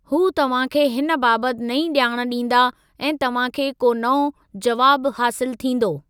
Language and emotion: Sindhi, neutral